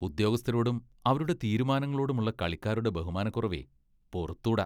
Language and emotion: Malayalam, disgusted